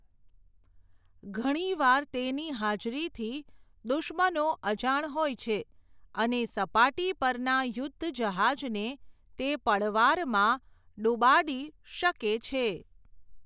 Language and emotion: Gujarati, neutral